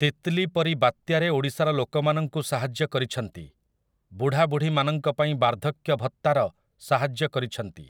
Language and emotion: Odia, neutral